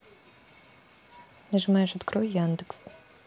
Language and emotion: Russian, neutral